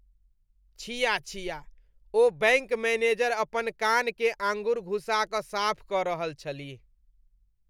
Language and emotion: Maithili, disgusted